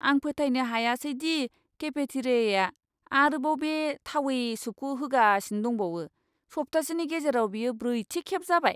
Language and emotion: Bodo, disgusted